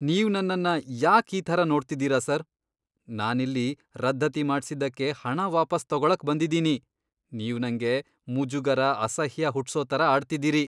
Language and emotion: Kannada, disgusted